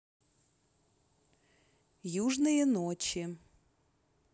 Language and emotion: Russian, neutral